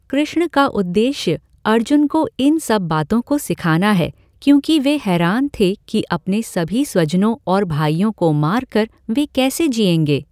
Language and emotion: Hindi, neutral